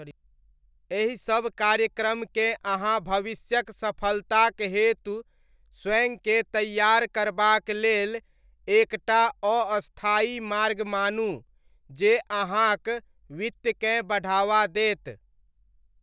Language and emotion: Maithili, neutral